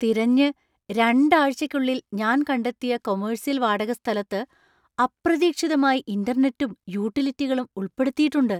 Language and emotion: Malayalam, surprised